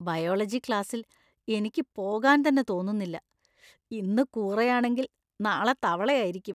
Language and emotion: Malayalam, disgusted